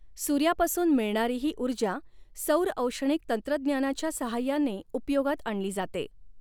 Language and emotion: Marathi, neutral